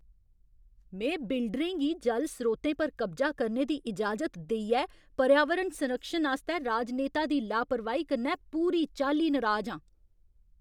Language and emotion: Dogri, angry